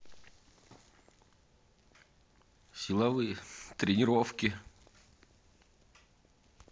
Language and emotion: Russian, neutral